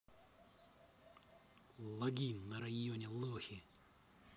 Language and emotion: Russian, angry